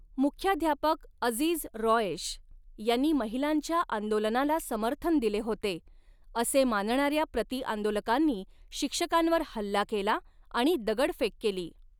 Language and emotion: Marathi, neutral